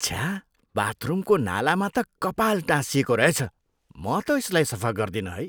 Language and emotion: Nepali, disgusted